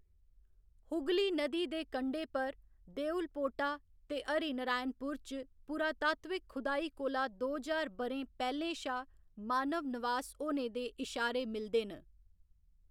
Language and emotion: Dogri, neutral